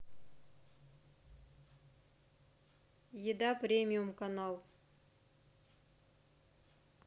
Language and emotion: Russian, neutral